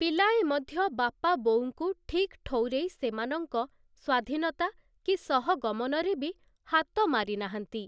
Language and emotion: Odia, neutral